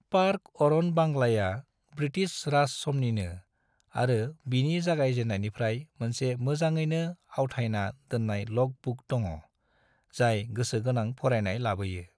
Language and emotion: Bodo, neutral